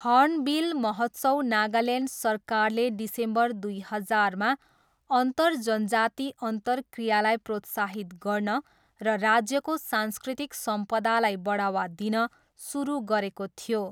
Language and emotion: Nepali, neutral